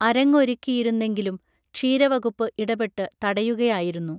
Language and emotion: Malayalam, neutral